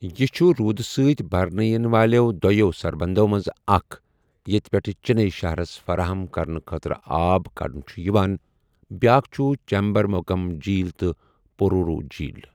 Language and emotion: Kashmiri, neutral